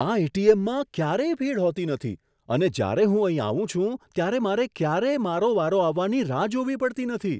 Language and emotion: Gujarati, surprised